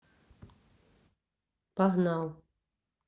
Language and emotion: Russian, neutral